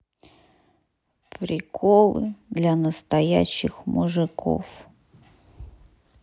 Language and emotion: Russian, sad